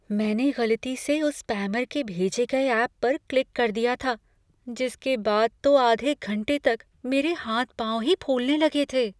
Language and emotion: Hindi, fearful